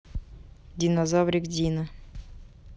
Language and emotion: Russian, neutral